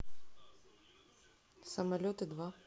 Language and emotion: Russian, neutral